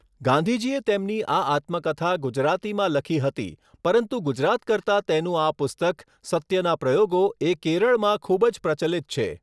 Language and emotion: Gujarati, neutral